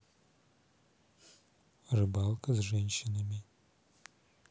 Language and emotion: Russian, neutral